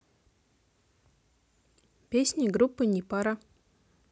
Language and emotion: Russian, neutral